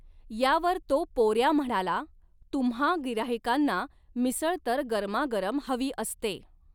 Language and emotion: Marathi, neutral